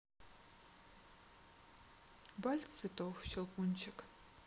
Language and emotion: Russian, neutral